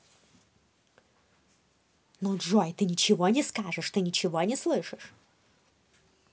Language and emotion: Russian, angry